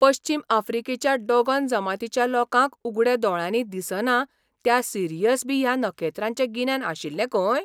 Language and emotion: Goan Konkani, surprised